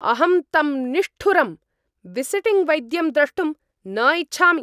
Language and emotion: Sanskrit, angry